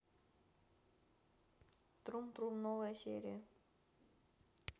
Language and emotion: Russian, neutral